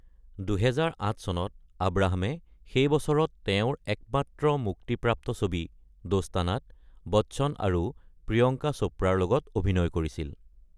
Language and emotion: Assamese, neutral